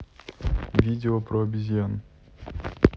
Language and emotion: Russian, neutral